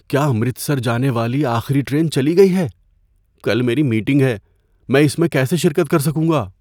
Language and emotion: Urdu, fearful